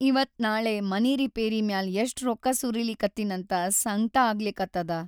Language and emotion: Kannada, sad